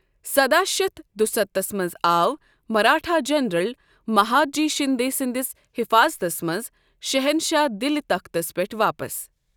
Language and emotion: Kashmiri, neutral